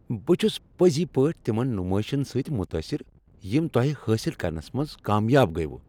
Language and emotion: Kashmiri, happy